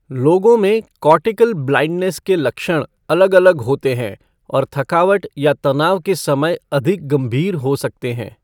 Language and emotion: Hindi, neutral